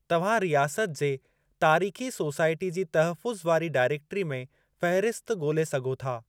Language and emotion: Sindhi, neutral